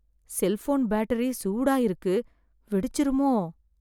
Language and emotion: Tamil, fearful